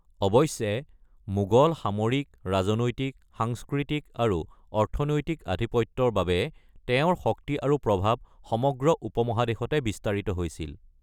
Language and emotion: Assamese, neutral